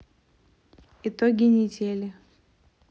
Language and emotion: Russian, neutral